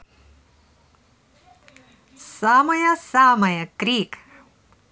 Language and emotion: Russian, positive